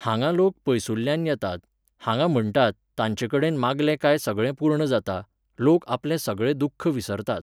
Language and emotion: Goan Konkani, neutral